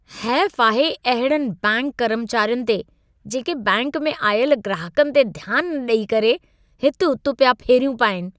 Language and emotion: Sindhi, disgusted